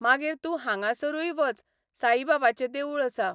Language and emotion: Goan Konkani, neutral